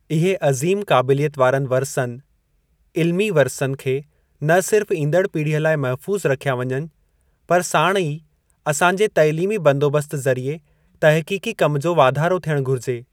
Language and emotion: Sindhi, neutral